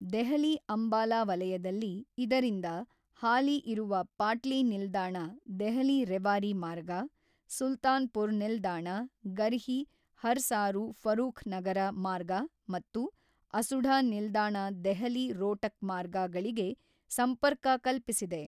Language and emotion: Kannada, neutral